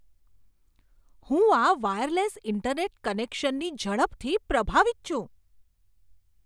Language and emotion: Gujarati, surprised